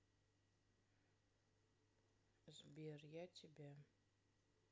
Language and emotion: Russian, sad